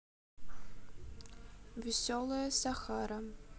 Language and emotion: Russian, neutral